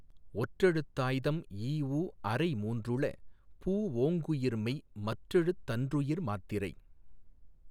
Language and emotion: Tamil, neutral